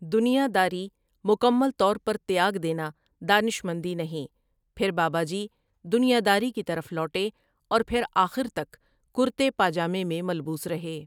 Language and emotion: Urdu, neutral